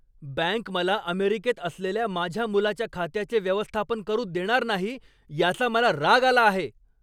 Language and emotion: Marathi, angry